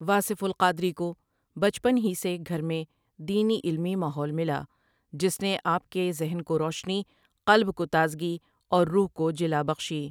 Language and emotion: Urdu, neutral